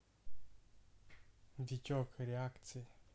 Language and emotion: Russian, neutral